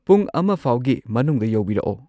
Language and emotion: Manipuri, neutral